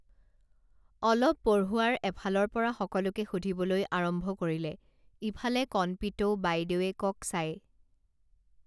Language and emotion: Assamese, neutral